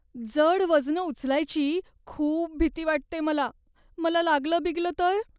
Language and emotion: Marathi, fearful